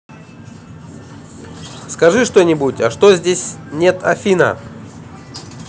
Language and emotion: Russian, positive